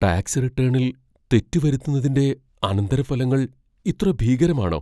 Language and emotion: Malayalam, fearful